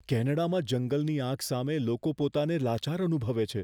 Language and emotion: Gujarati, fearful